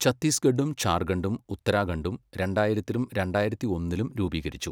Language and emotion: Malayalam, neutral